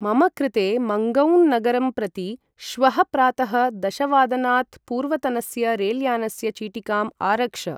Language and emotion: Sanskrit, neutral